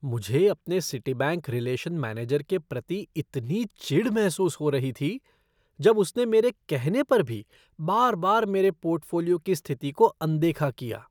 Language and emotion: Hindi, disgusted